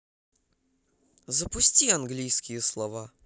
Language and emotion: Russian, neutral